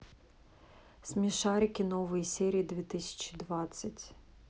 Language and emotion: Russian, neutral